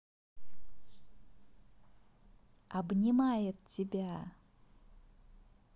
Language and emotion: Russian, positive